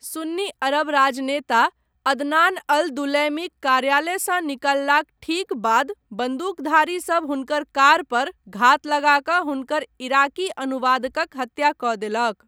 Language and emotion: Maithili, neutral